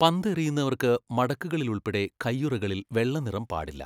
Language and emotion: Malayalam, neutral